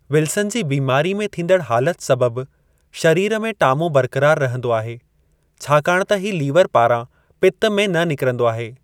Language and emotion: Sindhi, neutral